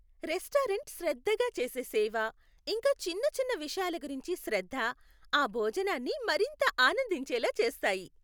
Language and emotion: Telugu, happy